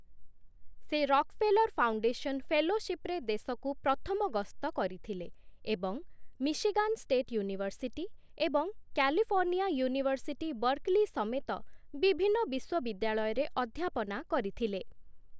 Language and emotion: Odia, neutral